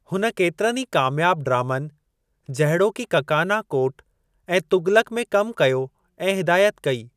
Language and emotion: Sindhi, neutral